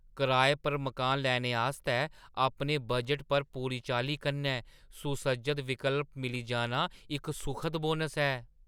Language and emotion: Dogri, surprised